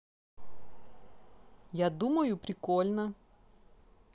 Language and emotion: Russian, positive